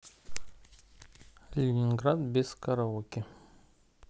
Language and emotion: Russian, neutral